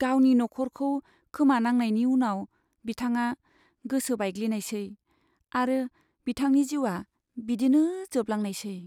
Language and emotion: Bodo, sad